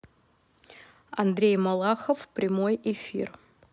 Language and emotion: Russian, neutral